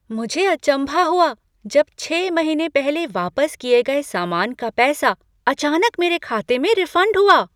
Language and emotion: Hindi, surprised